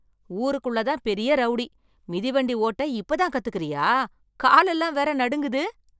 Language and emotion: Tamil, surprised